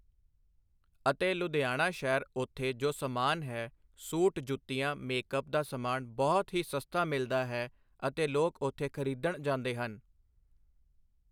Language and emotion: Punjabi, neutral